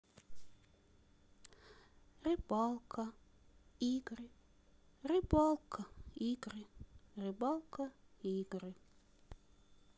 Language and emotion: Russian, sad